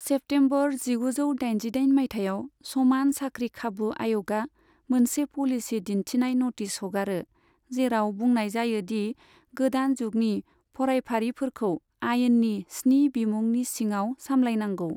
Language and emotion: Bodo, neutral